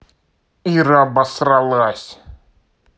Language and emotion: Russian, angry